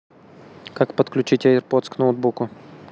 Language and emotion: Russian, neutral